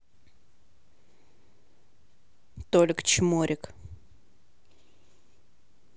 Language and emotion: Russian, angry